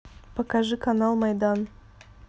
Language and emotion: Russian, neutral